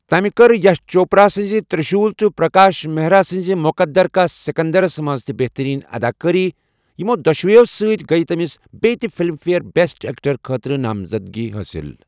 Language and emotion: Kashmiri, neutral